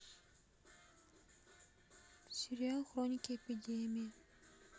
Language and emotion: Russian, sad